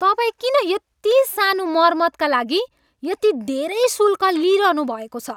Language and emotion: Nepali, angry